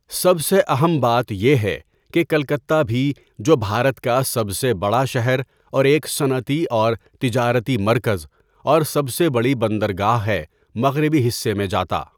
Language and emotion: Urdu, neutral